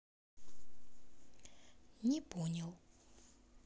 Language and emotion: Russian, neutral